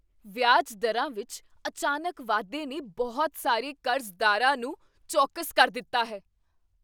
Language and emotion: Punjabi, surprised